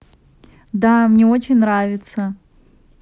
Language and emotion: Russian, positive